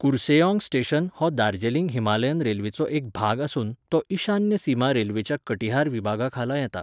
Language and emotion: Goan Konkani, neutral